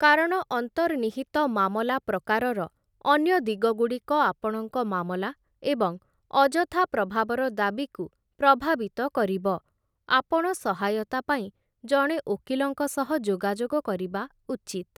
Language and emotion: Odia, neutral